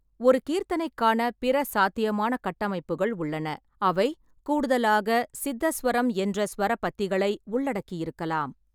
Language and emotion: Tamil, neutral